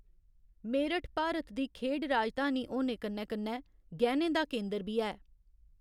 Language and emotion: Dogri, neutral